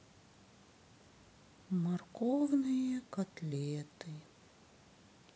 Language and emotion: Russian, sad